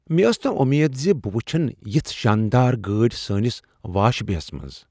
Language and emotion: Kashmiri, surprised